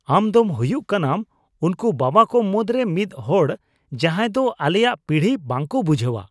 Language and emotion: Santali, disgusted